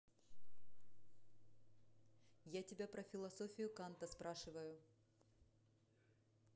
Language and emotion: Russian, angry